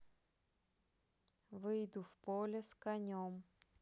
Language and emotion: Russian, neutral